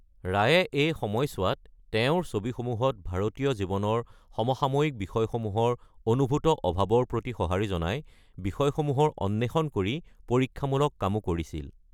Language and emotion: Assamese, neutral